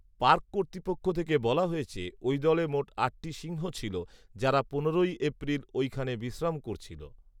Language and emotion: Bengali, neutral